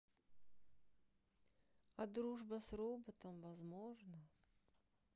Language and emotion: Russian, sad